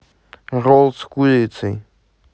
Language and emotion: Russian, neutral